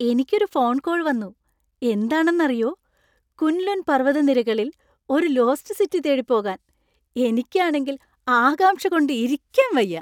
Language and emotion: Malayalam, happy